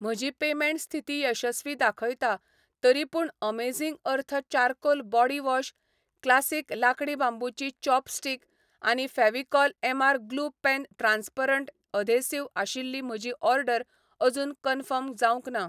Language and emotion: Goan Konkani, neutral